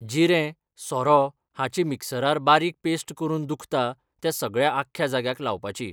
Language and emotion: Goan Konkani, neutral